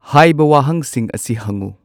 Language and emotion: Manipuri, neutral